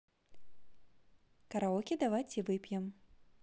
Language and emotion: Russian, positive